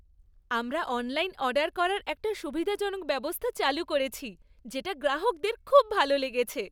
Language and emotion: Bengali, happy